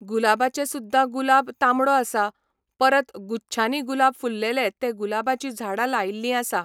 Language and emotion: Goan Konkani, neutral